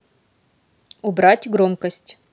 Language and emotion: Russian, neutral